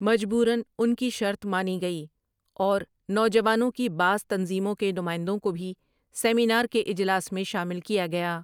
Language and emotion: Urdu, neutral